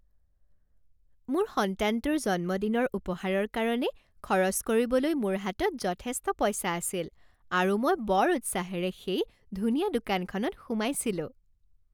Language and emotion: Assamese, happy